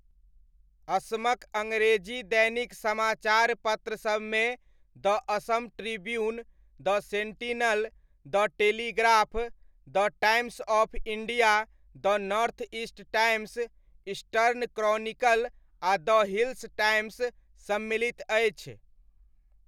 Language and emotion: Maithili, neutral